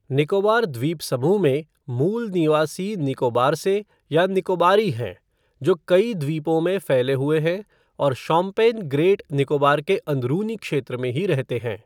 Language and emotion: Hindi, neutral